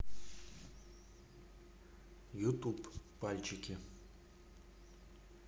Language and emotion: Russian, neutral